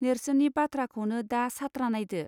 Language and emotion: Bodo, neutral